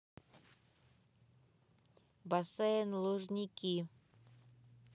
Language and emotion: Russian, neutral